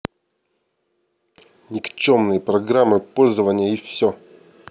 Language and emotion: Russian, angry